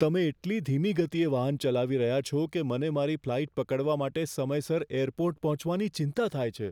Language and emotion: Gujarati, fearful